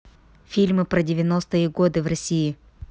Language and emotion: Russian, neutral